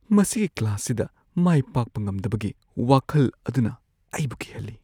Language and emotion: Manipuri, fearful